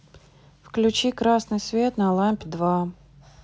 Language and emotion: Russian, neutral